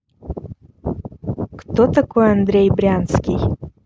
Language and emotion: Russian, neutral